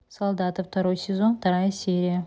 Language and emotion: Russian, neutral